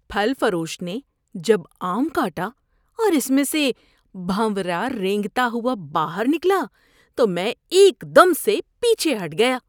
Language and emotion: Urdu, disgusted